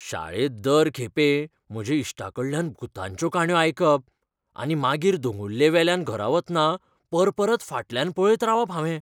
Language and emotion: Goan Konkani, fearful